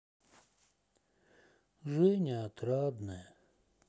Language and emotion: Russian, sad